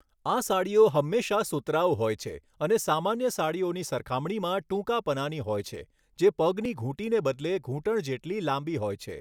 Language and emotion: Gujarati, neutral